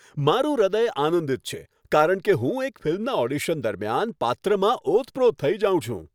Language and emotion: Gujarati, happy